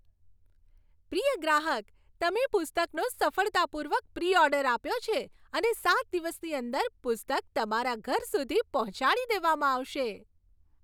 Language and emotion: Gujarati, happy